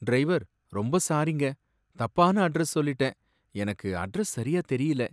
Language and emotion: Tamil, sad